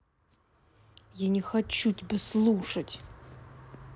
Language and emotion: Russian, angry